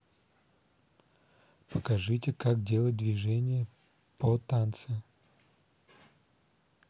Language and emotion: Russian, neutral